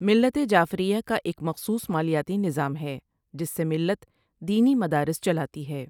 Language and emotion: Urdu, neutral